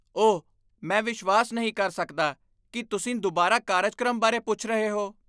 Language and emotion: Punjabi, disgusted